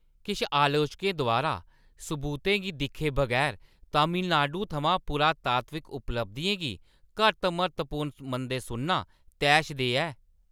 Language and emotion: Dogri, angry